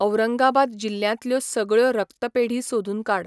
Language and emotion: Goan Konkani, neutral